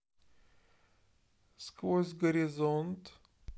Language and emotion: Russian, neutral